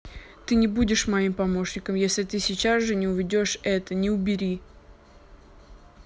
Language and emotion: Russian, angry